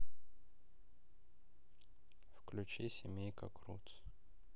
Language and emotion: Russian, sad